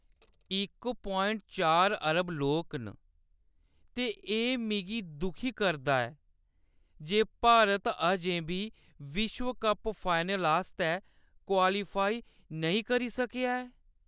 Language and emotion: Dogri, sad